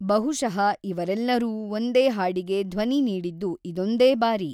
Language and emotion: Kannada, neutral